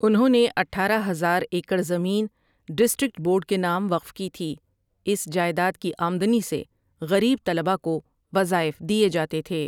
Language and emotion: Urdu, neutral